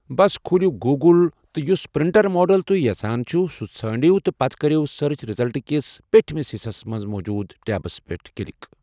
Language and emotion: Kashmiri, neutral